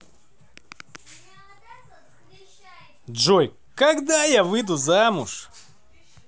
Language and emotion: Russian, positive